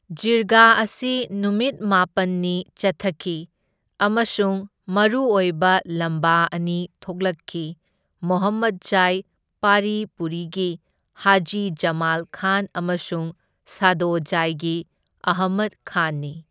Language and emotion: Manipuri, neutral